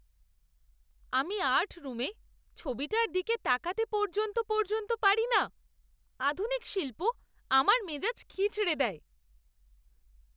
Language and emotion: Bengali, disgusted